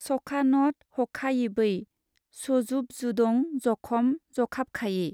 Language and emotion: Bodo, neutral